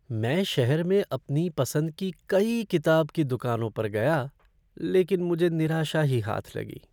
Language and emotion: Hindi, sad